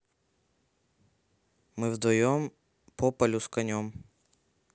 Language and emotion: Russian, neutral